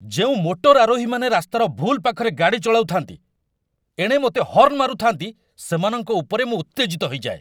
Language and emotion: Odia, angry